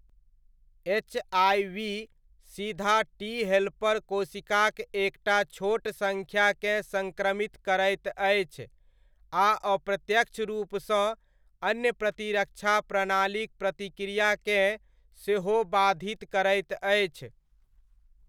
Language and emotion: Maithili, neutral